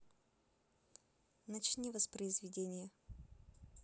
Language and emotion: Russian, neutral